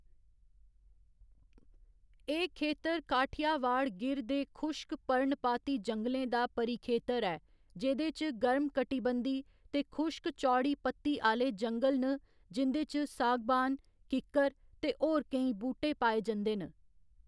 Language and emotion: Dogri, neutral